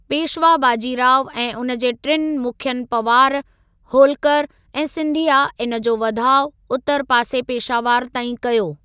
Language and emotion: Sindhi, neutral